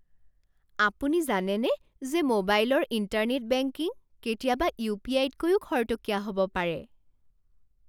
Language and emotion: Assamese, surprised